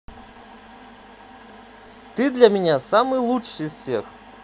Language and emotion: Russian, positive